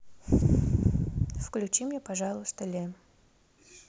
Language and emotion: Russian, neutral